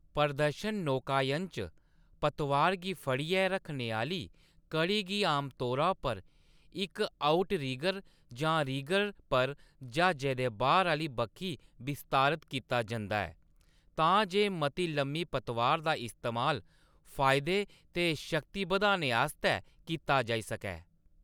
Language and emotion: Dogri, neutral